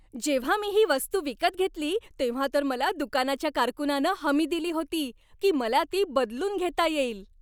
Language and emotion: Marathi, happy